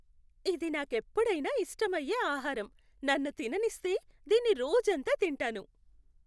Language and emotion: Telugu, happy